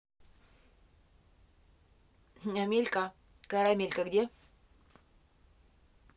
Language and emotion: Russian, neutral